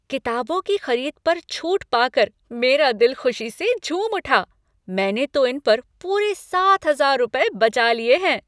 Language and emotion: Hindi, happy